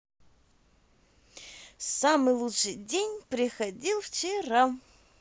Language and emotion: Russian, positive